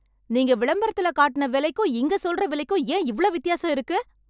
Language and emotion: Tamil, angry